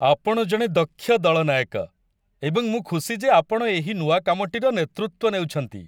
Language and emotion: Odia, happy